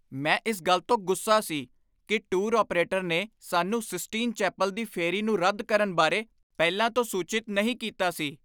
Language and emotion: Punjabi, angry